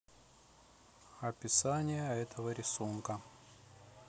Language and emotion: Russian, neutral